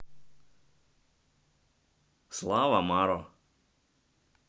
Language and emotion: Russian, neutral